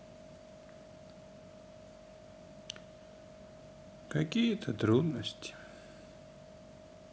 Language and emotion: Russian, sad